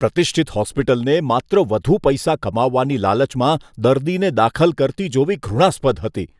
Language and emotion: Gujarati, disgusted